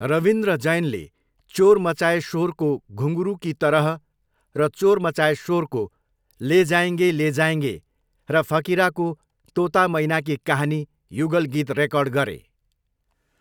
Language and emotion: Nepali, neutral